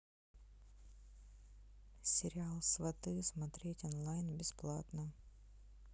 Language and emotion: Russian, neutral